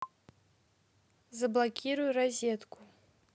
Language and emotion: Russian, neutral